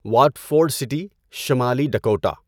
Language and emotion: Urdu, neutral